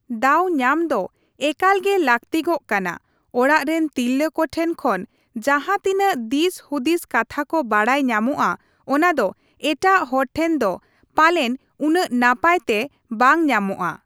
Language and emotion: Santali, neutral